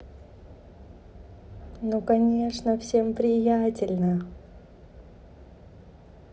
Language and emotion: Russian, positive